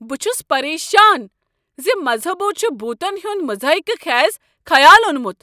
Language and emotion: Kashmiri, angry